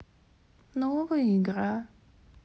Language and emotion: Russian, sad